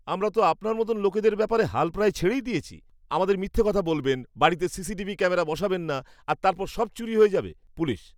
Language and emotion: Bengali, disgusted